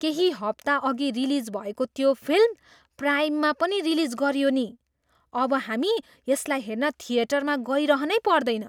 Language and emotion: Nepali, surprised